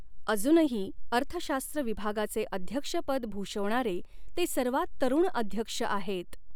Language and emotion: Marathi, neutral